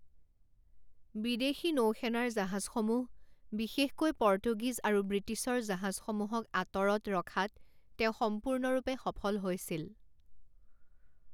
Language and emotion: Assamese, neutral